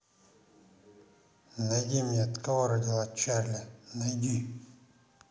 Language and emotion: Russian, neutral